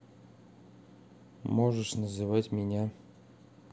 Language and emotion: Russian, neutral